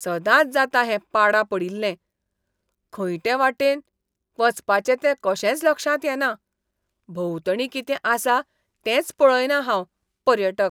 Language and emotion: Goan Konkani, disgusted